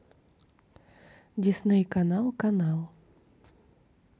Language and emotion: Russian, neutral